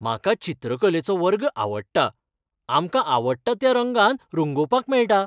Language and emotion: Goan Konkani, happy